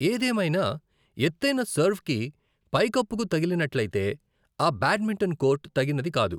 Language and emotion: Telugu, neutral